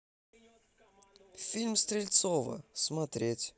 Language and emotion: Russian, neutral